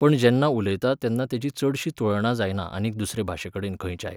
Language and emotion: Goan Konkani, neutral